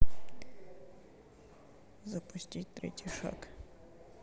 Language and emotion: Russian, neutral